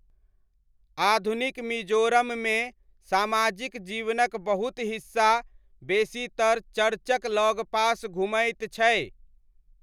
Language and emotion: Maithili, neutral